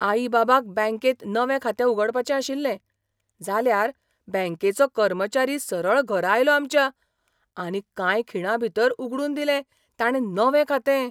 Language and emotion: Goan Konkani, surprised